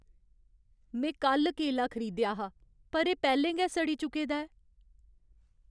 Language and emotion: Dogri, sad